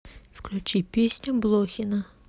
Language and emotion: Russian, neutral